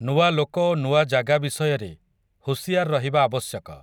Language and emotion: Odia, neutral